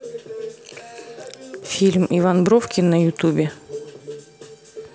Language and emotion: Russian, neutral